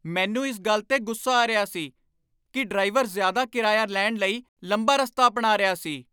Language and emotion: Punjabi, angry